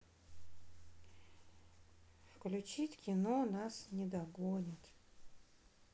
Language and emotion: Russian, sad